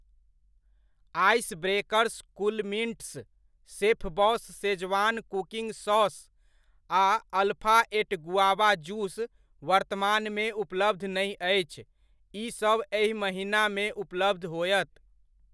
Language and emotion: Maithili, neutral